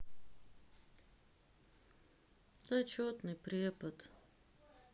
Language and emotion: Russian, sad